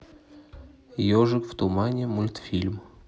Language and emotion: Russian, neutral